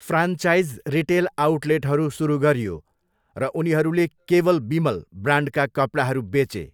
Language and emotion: Nepali, neutral